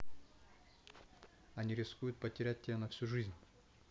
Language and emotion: Russian, neutral